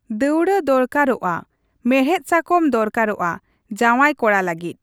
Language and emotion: Santali, neutral